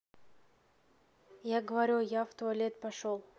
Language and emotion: Russian, neutral